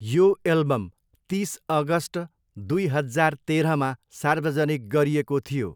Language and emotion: Nepali, neutral